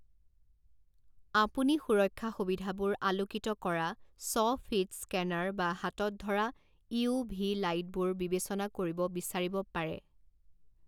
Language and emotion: Assamese, neutral